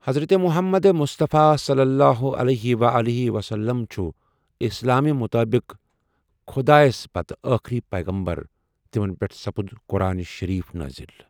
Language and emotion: Kashmiri, neutral